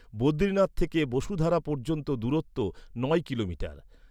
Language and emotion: Bengali, neutral